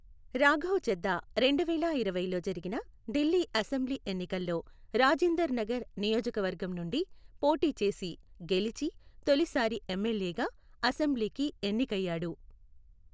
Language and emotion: Telugu, neutral